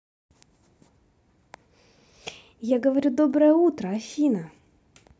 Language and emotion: Russian, positive